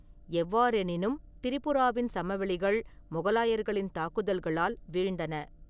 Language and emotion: Tamil, neutral